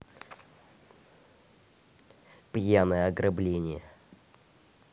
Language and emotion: Russian, neutral